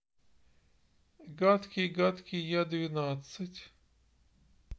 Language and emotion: Russian, neutral